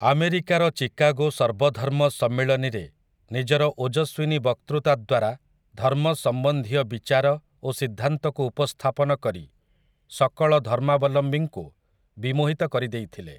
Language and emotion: Odia, neutral